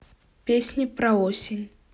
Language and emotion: Russian, neutral